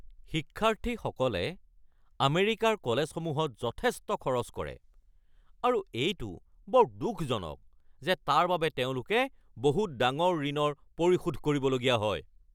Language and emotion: Assamese, angry